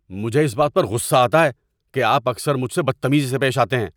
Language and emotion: Urdu, angry